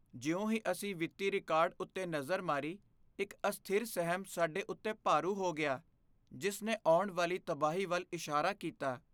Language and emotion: Punjabi, fearful